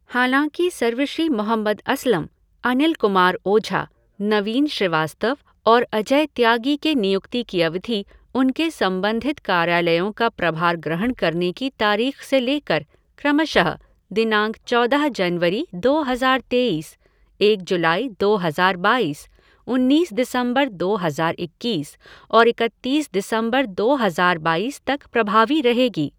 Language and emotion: Hindi, neutral